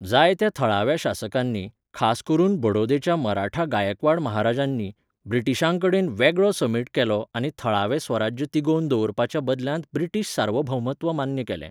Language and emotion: Goan Konkani, neutral